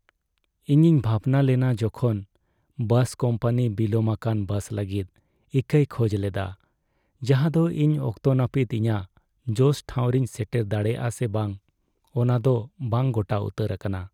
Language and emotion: Santali, sad